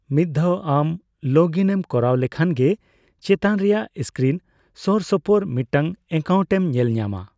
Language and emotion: Santali, neutral